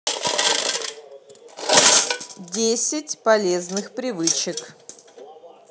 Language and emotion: Russian, neutral